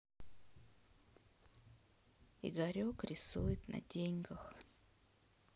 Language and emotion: Russian, sad